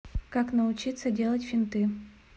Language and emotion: Russian, neutral